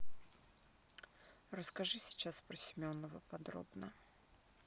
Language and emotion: Russian, neutral